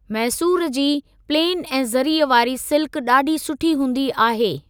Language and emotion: Sindhi, neutral